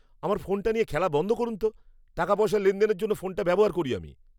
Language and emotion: Bengali, angry